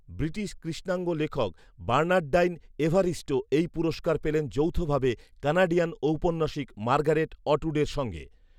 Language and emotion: Bengali, neutral